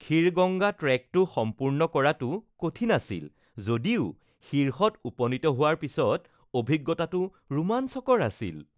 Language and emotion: Assamese, happy